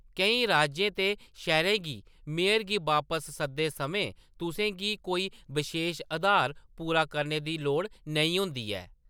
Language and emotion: Dogri, neutral